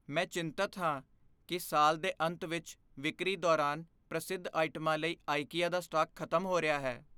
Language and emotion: Punjabi, fearful